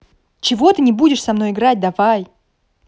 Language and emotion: Russian, angry